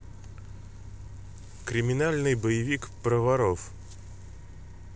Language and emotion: Russian, neutral